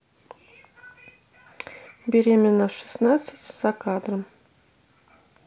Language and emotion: Russian, neutral